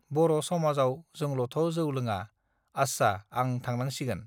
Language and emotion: Bodo, neutral